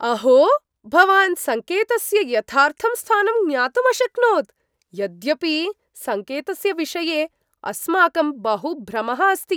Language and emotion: Sanskrit, surprised